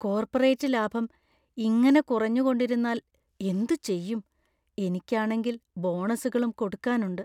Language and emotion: Malayalam, fearful